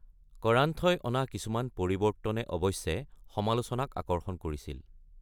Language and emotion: Assamese, neutral